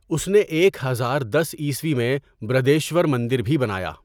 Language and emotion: Urdu, neutral